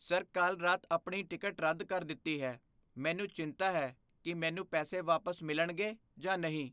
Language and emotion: Punjabi, fearful